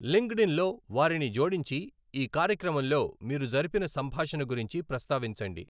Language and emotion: Telugu, neutral